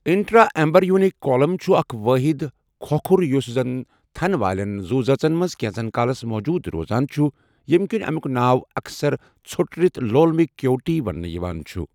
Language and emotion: Kashmiri, neutral